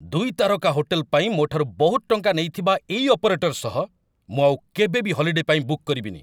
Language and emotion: Odia, angry